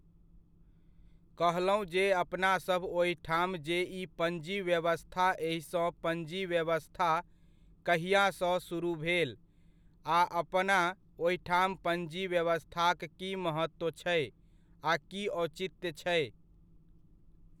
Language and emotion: Maithili, neutral